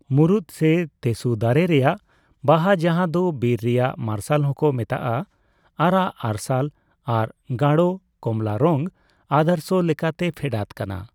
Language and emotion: Santali, neutral